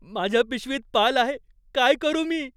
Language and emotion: Marathi, fearful